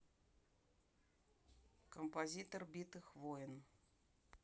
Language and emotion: Russian, neutral